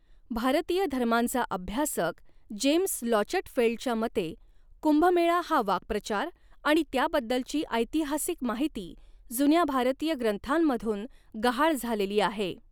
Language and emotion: Marathi, neutral